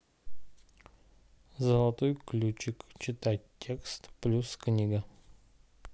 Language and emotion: Russian, neutral